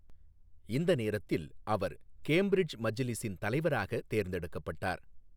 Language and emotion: Tamil, neutral